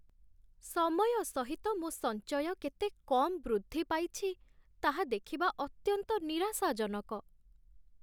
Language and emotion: Odia, sad